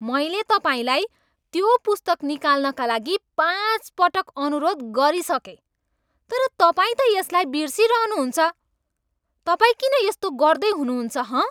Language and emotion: Nepali, angry